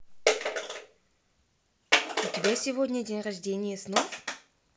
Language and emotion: Russian, neutral